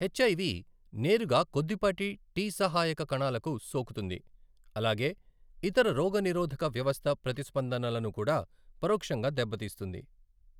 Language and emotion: Telugu, neutral